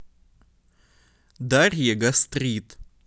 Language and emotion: Russian, neutral